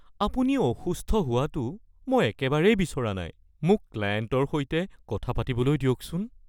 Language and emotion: Assamese, fearful